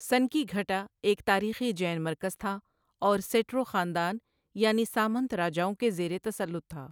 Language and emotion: Urdu, neutral